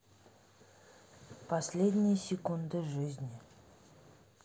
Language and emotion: Russian, sad